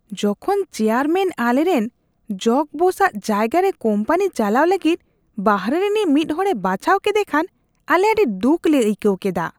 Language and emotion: Santali, disgusted